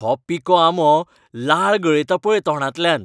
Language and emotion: Goan Konkani, happy